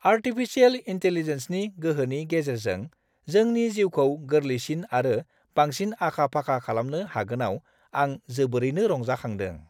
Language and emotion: Bodo, happy